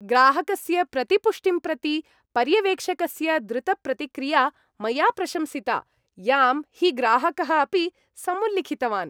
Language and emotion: Sanskrit, happy